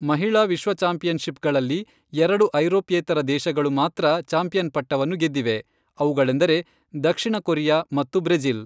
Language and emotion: Kannada, neutral